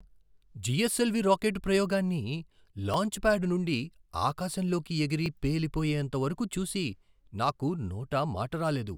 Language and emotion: Telugu, surprised